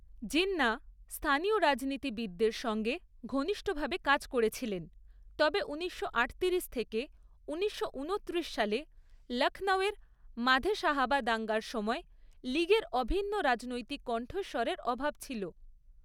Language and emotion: Bengali, neutral